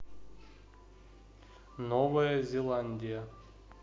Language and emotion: Russian, neutral